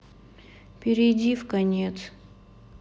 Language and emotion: Russian, sad